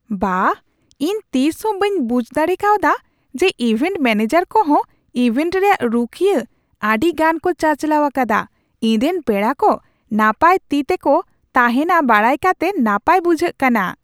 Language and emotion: Santali, surprised